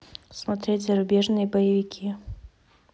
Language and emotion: Russian, neutral